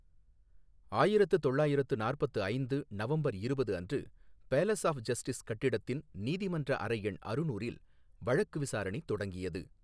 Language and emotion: Tamil, neutral